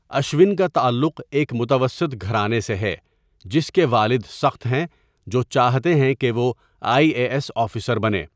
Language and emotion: Urdu, neutral